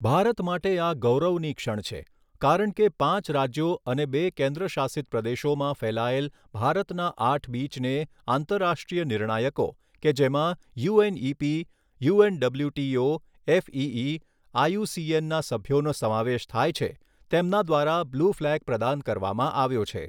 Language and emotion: Gujarati, neutral